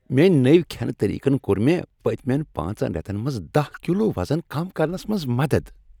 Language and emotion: Kashmiri, happy